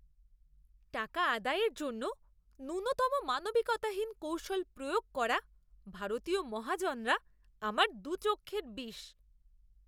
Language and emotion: Bengali, disgusted